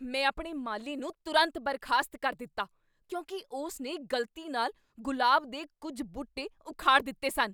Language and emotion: Punjabi, angry